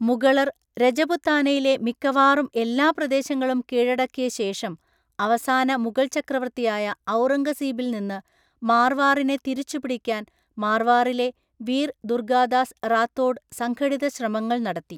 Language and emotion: Malayalam, neutral